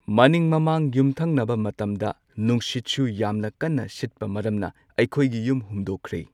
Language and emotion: Manipuri, neutral